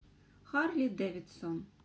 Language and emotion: Russian, neutral